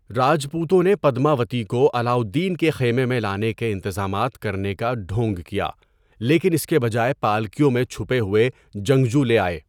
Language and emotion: Urdu, neutral